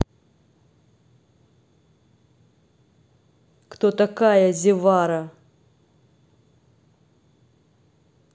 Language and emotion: Russian, angry